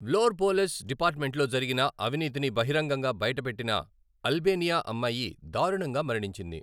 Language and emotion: Telugu, neutral